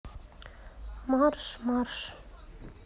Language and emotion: Russian, neutral